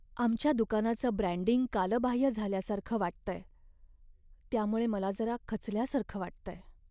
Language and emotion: Marathi, sad